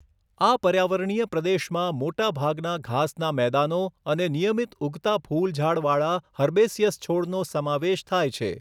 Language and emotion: Gujarati, neutral